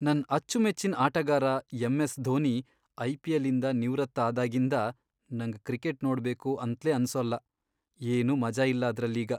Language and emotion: Kannada, sad